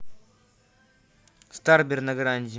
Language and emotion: Russian, neutral